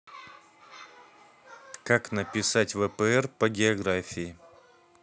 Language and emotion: Russian, neutral